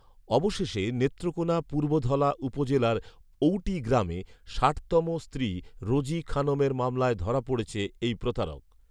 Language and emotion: Bengali, neutral